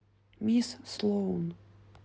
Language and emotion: Russian, neutral